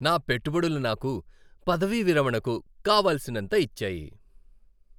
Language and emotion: Telugu, happy